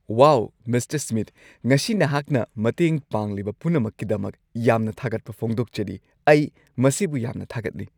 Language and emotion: Manipuri, happy